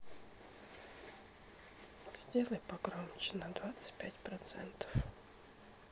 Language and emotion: Russian, sad